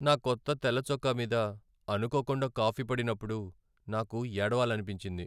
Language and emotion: Telugu, sad